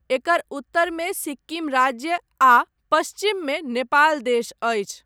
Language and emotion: Maithili, neutral